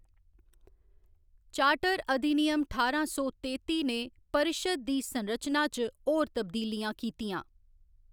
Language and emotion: Dogri, neutral